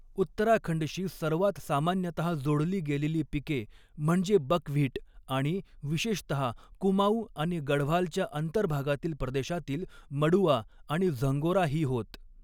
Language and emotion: Marathi, neutral